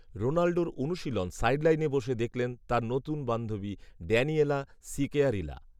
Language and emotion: Bengali, neutral